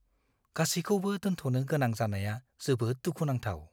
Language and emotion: Bodo, fearful